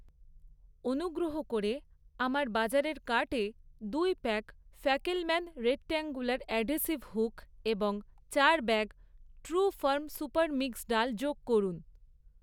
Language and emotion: Bengali, neutral